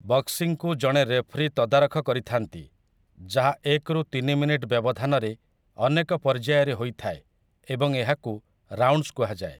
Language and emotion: Odia, neutral